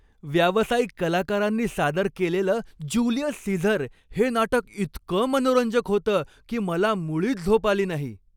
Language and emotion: Marathi, happy